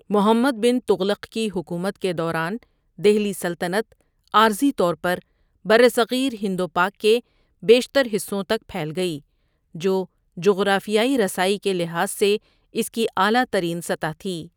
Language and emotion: Urdu, neutral